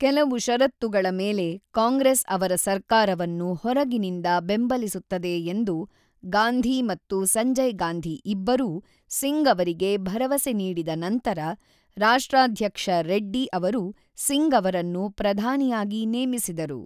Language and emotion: Kannada, neutral